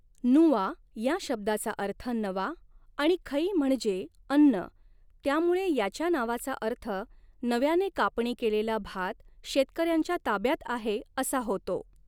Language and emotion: Marathi, neutral